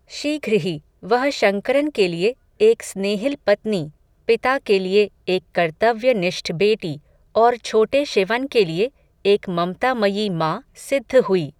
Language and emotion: Hindi, neutral